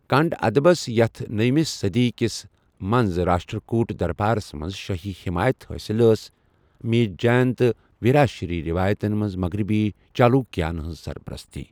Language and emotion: Kashmiri, neutral